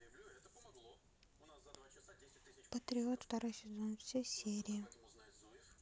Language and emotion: Russian, neutral